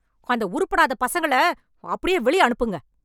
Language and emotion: Tamil, angry